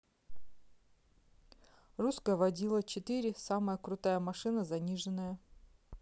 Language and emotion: Russian, neutral